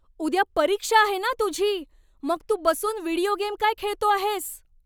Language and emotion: Marathi, angry